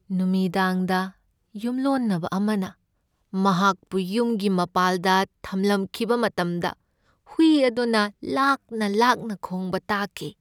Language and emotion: Manipuri, sad